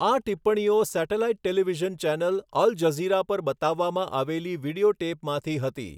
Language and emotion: Gujarati, neutral